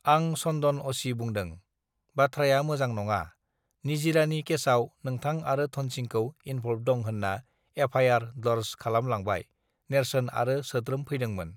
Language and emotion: Bodo, neutral